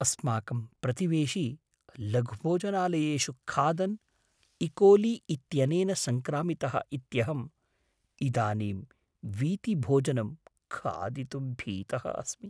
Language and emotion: Sanskrit, fearful